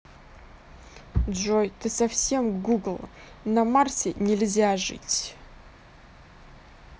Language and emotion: Russian, angry